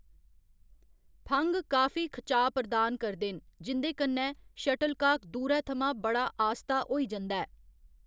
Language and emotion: Dogri, neutral